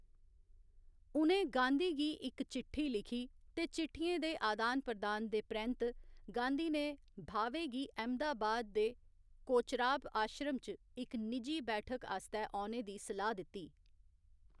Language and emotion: Dogri, neutral